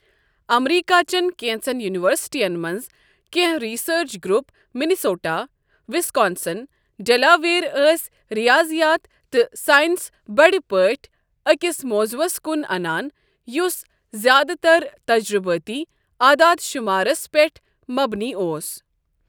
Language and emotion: Kashmiri, neutral